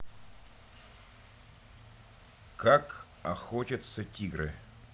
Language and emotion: Russian, neutral